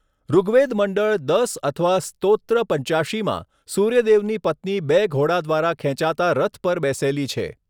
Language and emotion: Gujarati, neutral